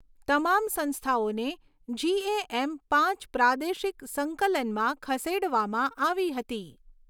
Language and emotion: Gujarati, neutral